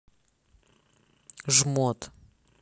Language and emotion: Russian, angry